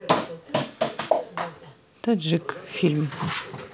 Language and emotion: Russian, neutral